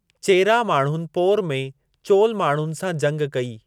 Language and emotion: Sindhi, neutral